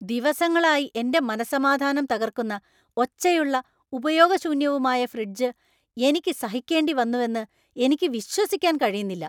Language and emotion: Malayalam, angry